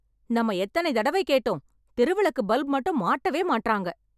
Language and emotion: Tamil, angry